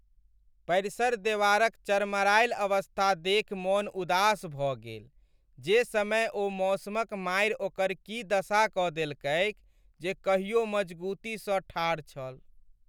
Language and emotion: Maithili, sad